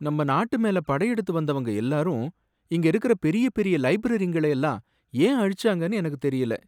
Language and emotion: Tamil, sad